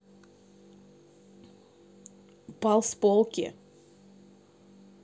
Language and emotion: Russian, neutral